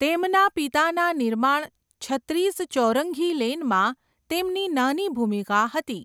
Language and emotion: Gujarati, neutral